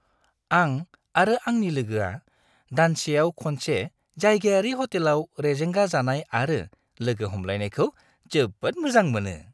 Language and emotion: Bodo, happy